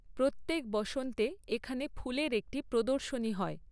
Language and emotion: Bengali, neutral